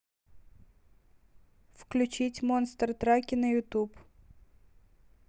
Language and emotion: Russian, neutral